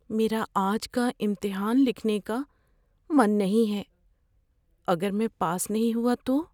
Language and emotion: Urdu, fearful